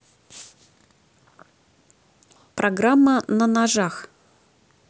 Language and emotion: Russian, neutral